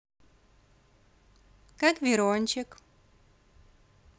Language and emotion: Russian, positive